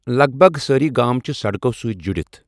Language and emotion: Kashmiri, neutral